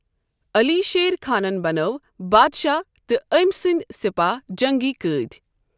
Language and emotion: Kashmiri, neutral